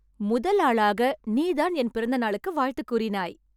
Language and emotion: Tamil, happy